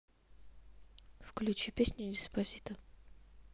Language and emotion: Russian, neutral